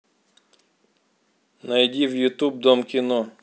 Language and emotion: Russian, neutral